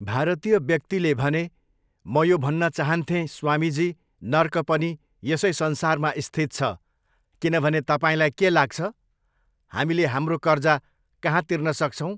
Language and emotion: Nepali, neutral